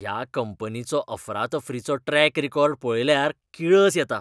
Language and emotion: Goan Konkani, disgusted